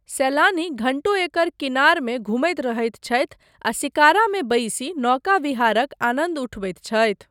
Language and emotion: Maithili, neutral